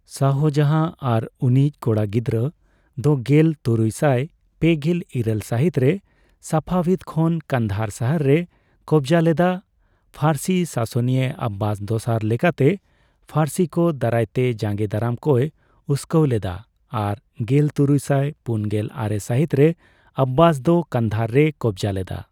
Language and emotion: Santali, neutral